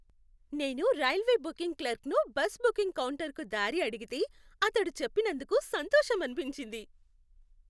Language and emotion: Telugu, happy